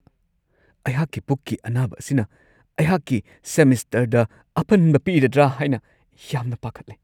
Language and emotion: Manipuri, fearful